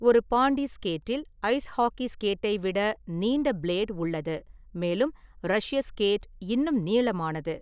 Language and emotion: Tamil, neutral